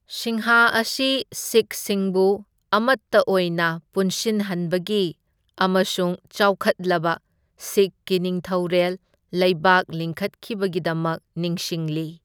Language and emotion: Manipuri, neutral